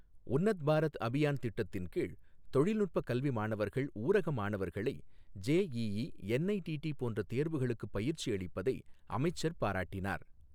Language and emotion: Tamil, neutral